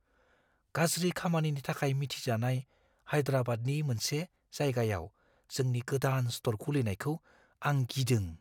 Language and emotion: Bodo, fearful